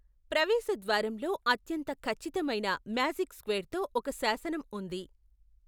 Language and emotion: Telugu, neutral